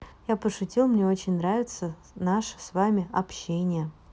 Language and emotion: Russian, positive